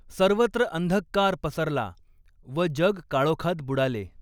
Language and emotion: Marathi, neutral